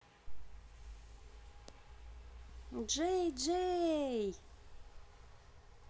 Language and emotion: Russian, positive